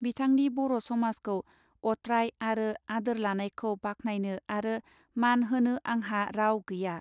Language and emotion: Bodo, neutral